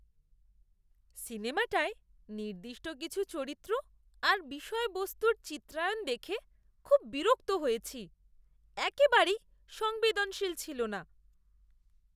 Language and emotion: Bengali, disgusted